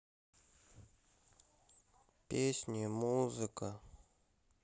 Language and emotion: Russian, sad